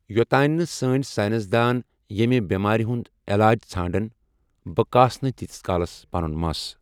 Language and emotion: Kashmiri, neutral